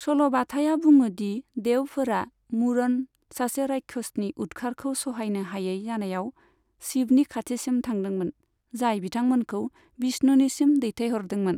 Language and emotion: Bodo, neutral